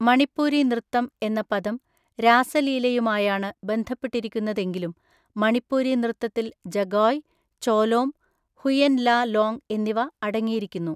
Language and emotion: Malayalam, neutral